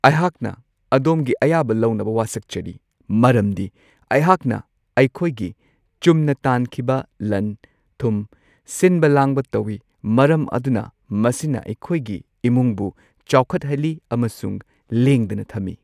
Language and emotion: Manipuri, neutral